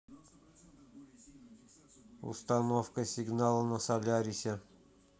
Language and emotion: Russian, neutral